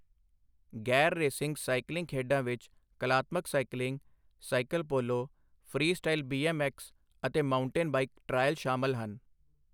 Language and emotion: Punjabi, neutral